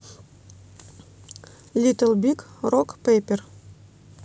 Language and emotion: Russian, neutral